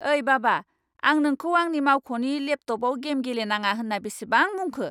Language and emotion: Bodo, angry